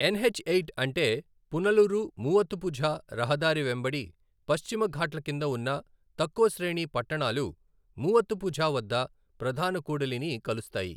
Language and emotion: Telugu, neutral